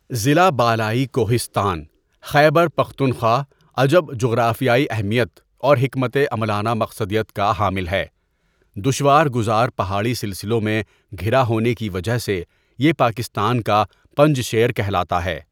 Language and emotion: Urdu, neutral